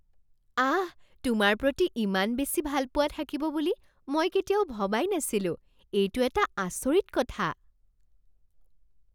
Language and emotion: Assamese, surprised